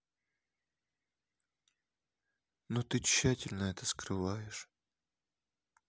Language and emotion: Russian, sad